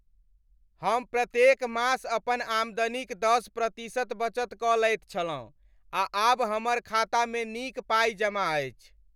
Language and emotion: Maithili, happy